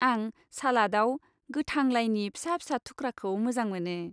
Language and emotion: Bodo, happy